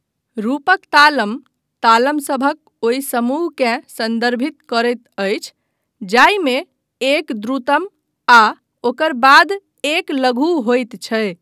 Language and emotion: Maithili, neutral